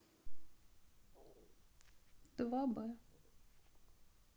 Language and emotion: Russian, sad